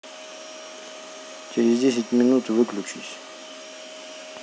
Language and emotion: Russian, neutral